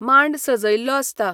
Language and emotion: Goan Konkani, neutral